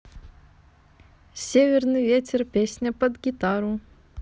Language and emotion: Russian, positive